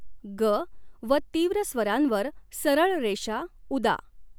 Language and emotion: Marathi, neutral